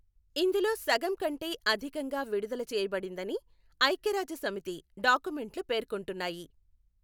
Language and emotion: Telugu, neutral